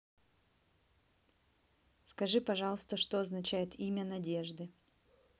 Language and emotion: Russian, neutral